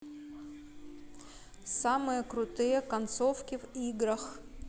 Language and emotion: Russian, neutral